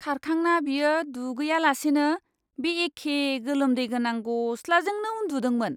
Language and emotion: Bodo, disgusted